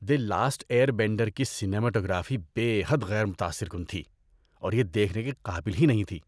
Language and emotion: Urdu, disgusted